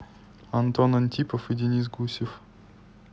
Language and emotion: Russian, neutral